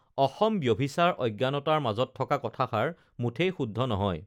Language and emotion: Assamese, neutral